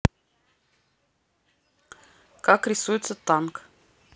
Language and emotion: Russian, neutral